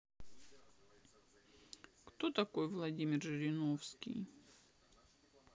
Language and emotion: Russian, sad